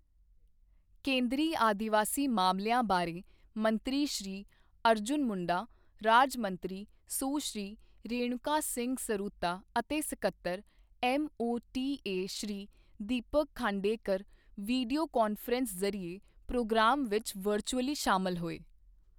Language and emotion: Punjabi, neutral